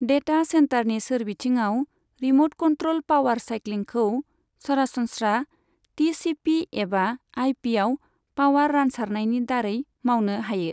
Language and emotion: Bodo, neutral